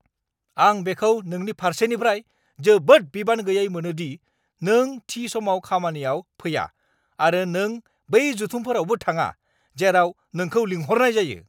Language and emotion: Bodo, angry